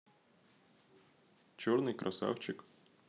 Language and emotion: Russian, neutral